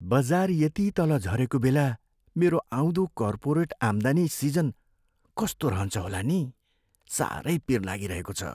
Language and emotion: Nepali, fearful